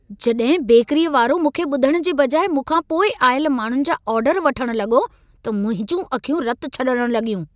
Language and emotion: Sindhi, angry